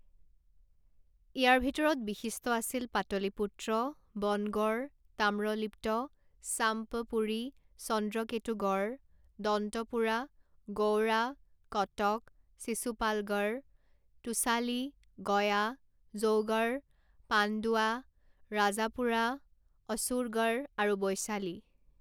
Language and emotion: Assamese, neutral